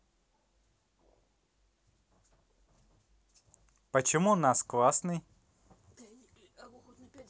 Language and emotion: Russian, positive